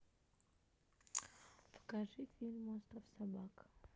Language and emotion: Russian, neutral